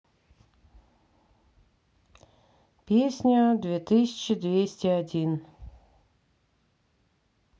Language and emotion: Russian, neutral